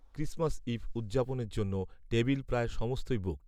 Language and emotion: Bengali, neutral